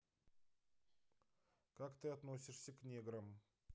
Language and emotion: Russian, neutral